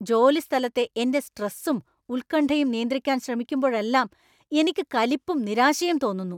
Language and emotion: Malayalam, angry